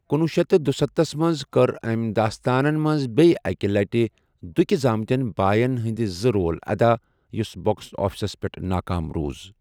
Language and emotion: Kashmiri, neutral